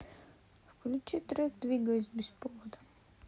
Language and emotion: Russian, sad